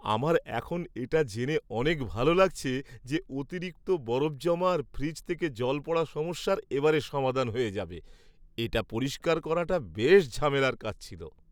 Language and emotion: Bengali, happy